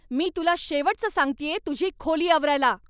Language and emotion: Marathi, angry